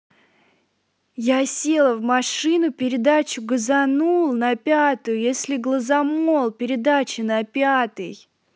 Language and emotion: Russian, positive